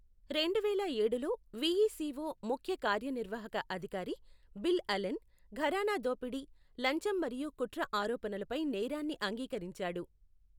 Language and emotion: Telugu, neutral